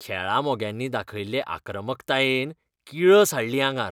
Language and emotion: Goan Konkani, disgusted